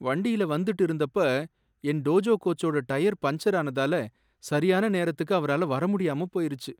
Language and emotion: Tamil, sad